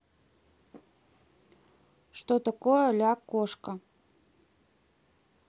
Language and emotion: Russian, neutral